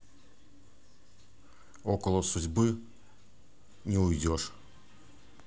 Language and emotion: Russian, neutral